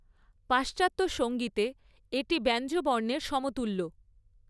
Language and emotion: Bengali, neutral